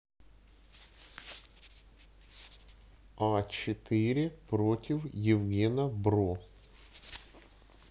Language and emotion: Russian, neutral